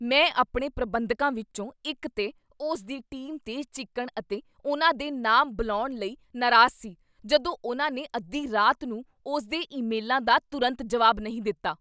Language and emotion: Punjabi, angry